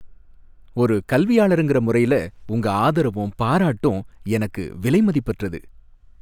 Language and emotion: Tamil, happy